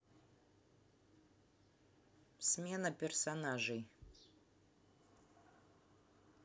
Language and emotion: Russian, neutral